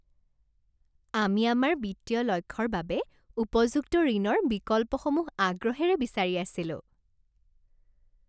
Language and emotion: Assamese, happy